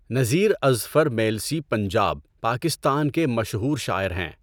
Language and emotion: Urdu, neutral